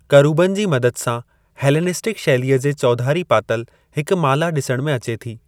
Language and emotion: Sindhi, neutral